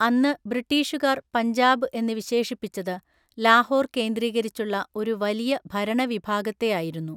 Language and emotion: Malayalam, neutral